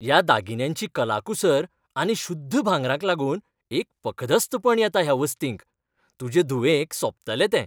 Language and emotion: Goan Konkani, happy